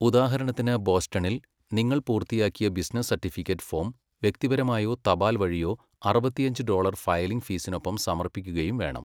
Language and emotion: Malayalam, neutral